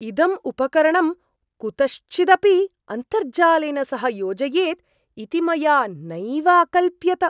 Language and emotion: Sanskrit, surprised